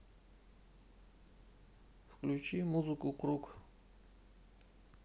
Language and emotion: Russian, neutral